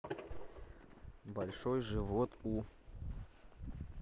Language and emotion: Russian, neutral